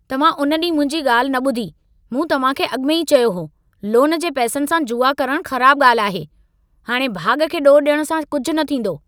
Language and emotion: Sindhi, angry